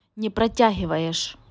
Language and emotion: Russian, neutral